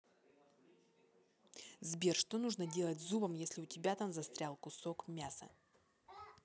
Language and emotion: Russian, neutral